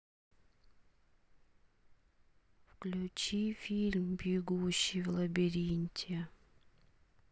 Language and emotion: Russian, sad